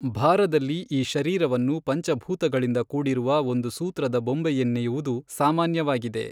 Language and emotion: Kannada, neutral